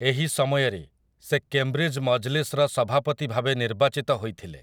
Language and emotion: Odia, neutral